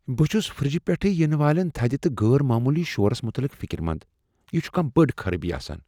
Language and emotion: Kashmiri, fearful